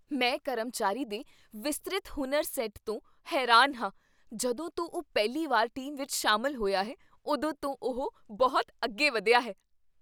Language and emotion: Punjabi, surprised